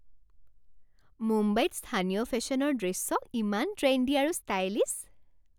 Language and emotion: Assamese, happy